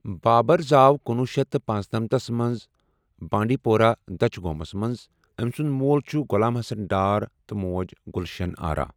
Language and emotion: Kashmiri, neutral